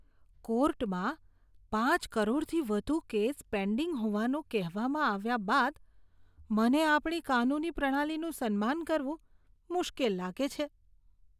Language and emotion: Gujarati, disgusted